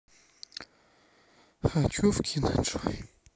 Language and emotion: Russian, sad